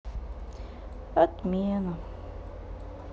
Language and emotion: Russian, sad